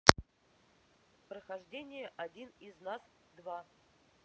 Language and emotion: Russian, neutral